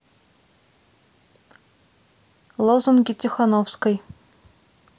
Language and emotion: Russian, neutral